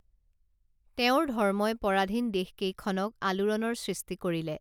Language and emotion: Assamese, neutral